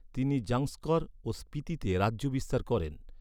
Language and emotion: Bengali, neutral